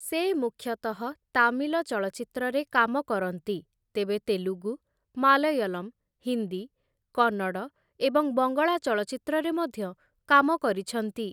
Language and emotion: Odia, neutral